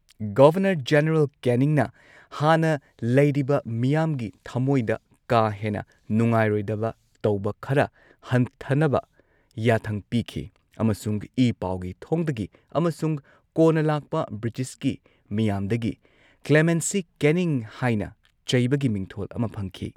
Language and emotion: Manipuri, neutral